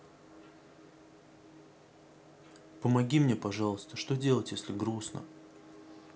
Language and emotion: Russian, sad